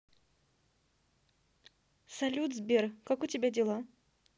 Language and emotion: Russian, neutral